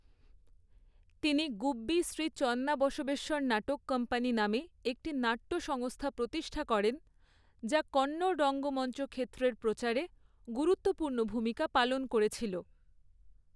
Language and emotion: Bengali, neutral